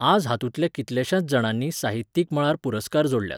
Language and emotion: Goan Konkani, neutral